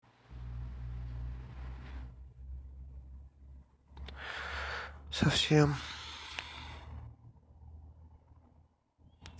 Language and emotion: Russian, sad